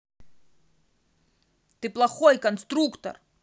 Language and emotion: Russian, angry